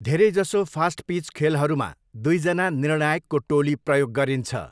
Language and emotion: Nepali, neutral